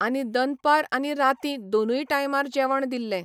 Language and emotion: Goan Konkani, neutral